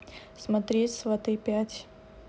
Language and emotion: Russian, neutral